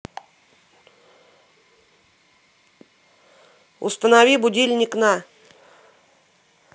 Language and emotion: Russian, neutral